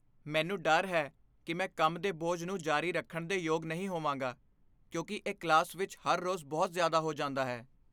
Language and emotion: Punjabi, fearful